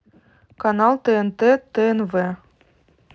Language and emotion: Russian, neutral